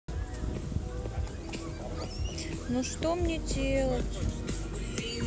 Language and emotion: Russian, sad